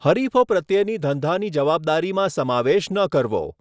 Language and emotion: Gujarati, neutral